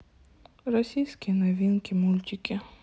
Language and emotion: Russian, sad